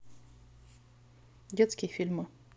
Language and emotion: Russian, neutral